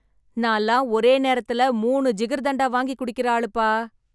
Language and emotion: Tamil, happy